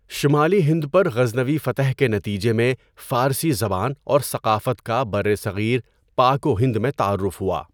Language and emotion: Urdu, neutral